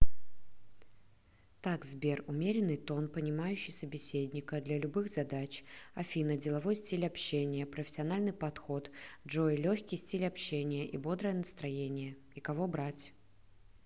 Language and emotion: Russian, neutral